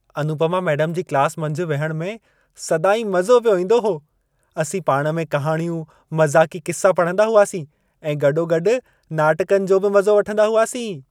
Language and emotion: Sindhi, happy